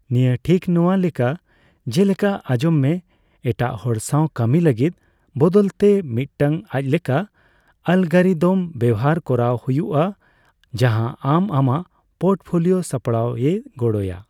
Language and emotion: Santali, neutral